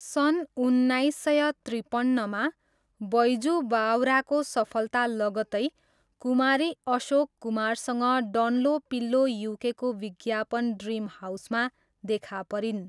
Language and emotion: Nepali, neutral